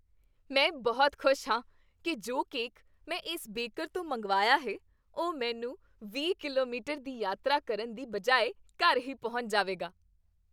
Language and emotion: Punjabi, happy